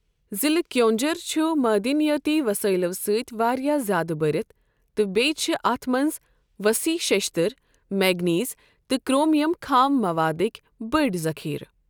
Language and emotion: Kashmiri, neutral